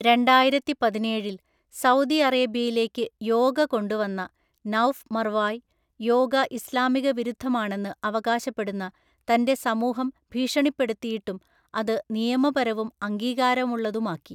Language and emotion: Malayalam, neutral